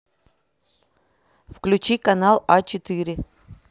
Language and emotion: Russian, neutral